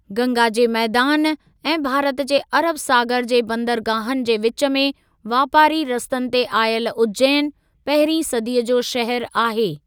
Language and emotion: Sindhi, neutral